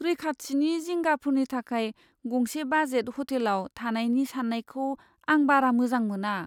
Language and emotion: Bodo, fearful